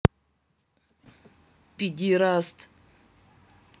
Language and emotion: Russian, angry